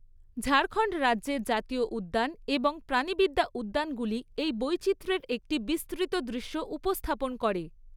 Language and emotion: Bengali, neutral